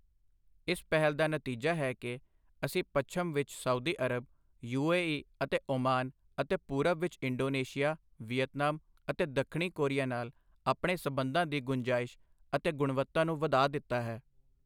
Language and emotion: Punjabi, neutral